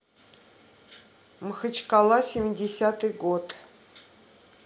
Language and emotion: Russian, neutral